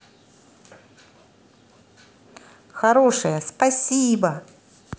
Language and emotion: Russian, positive